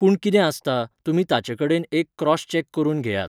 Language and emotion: Goan Konkani, neutral